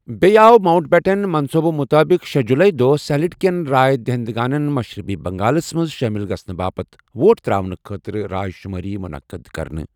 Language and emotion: Kashmiri, neutral